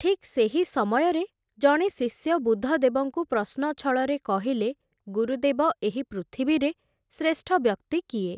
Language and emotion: Odia, neutral